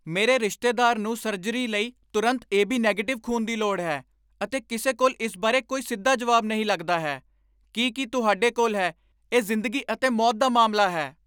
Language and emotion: Punjabi, angry